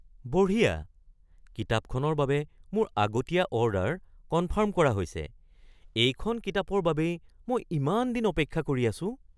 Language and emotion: Assamese, surprised